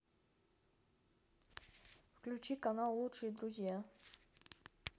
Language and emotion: Russian, neutral